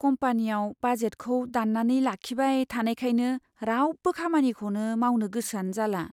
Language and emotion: Bodo, sad